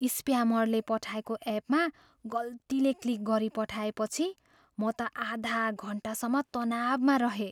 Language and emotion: Nepali, fearful